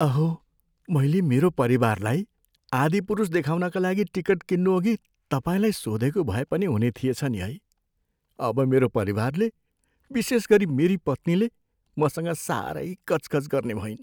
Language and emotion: Nepali, fearful